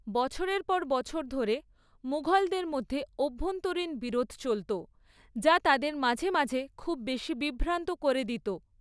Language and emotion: Bengali, neutral